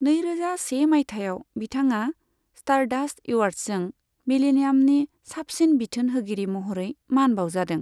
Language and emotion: Bodo, neutral